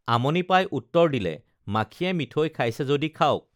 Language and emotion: Assamese, neutral